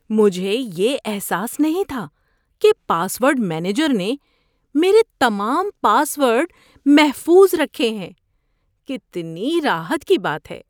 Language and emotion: Urdu, surprised